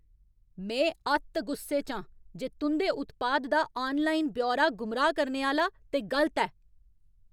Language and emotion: Dogri, angry